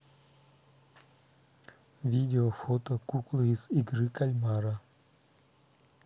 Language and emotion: Russian, neutral